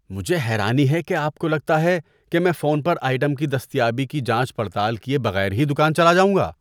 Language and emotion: Urdu, disgusted